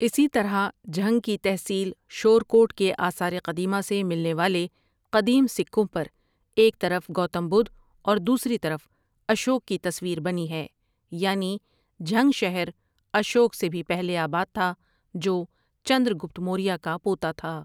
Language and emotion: Urdu, neutral